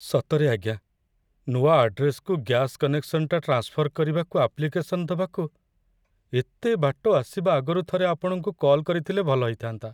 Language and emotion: Odia, sad